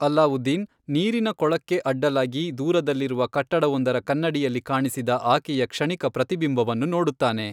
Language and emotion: Kannada, neutral